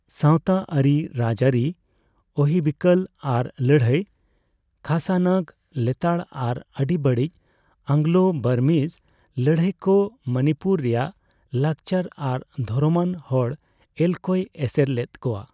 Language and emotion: Santali, neutral